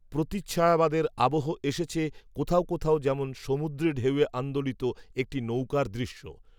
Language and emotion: Bengali, neutral